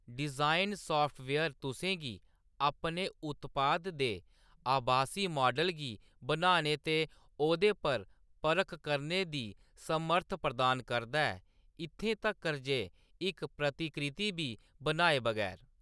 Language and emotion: Dogri, neutral